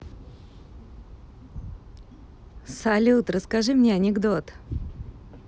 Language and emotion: Russian, positive